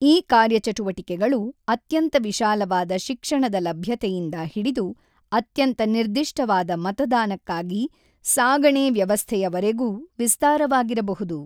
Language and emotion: Kannada, neutral